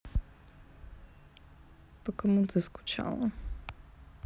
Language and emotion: Russian, sad